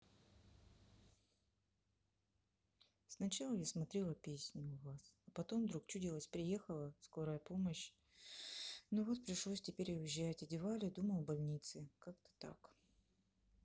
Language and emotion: Russian, sad